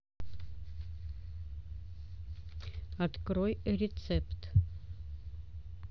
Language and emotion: Russian, neutral